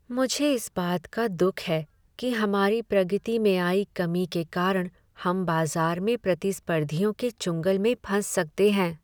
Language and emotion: Hindi, sad